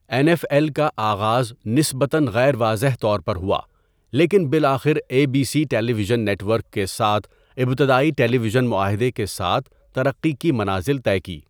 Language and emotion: Urdu, neutral